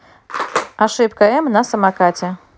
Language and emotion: Russian, neutral